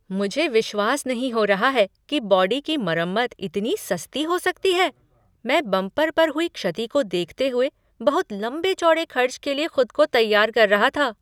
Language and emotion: Hindi, surprised